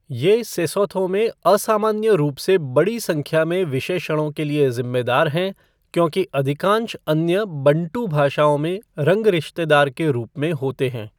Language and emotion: Hindi, neutral